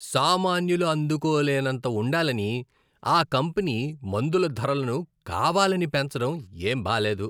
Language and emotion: Telugu, disgusted